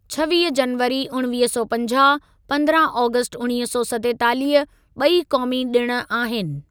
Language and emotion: Sindhi, neutral